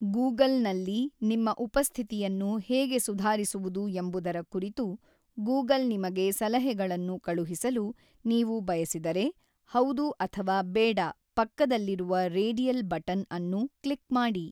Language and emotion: Kannada, neutral